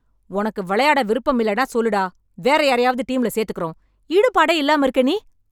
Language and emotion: Tamil, angry